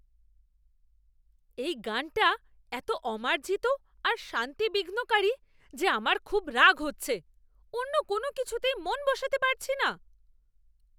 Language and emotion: Bengali, angry